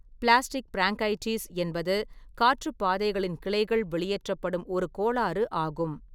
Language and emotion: Tamil, neutral